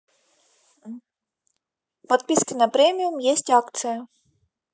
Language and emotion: Russian, neutral